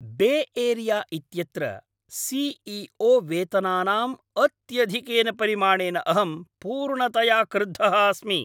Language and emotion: Sanskrit, angry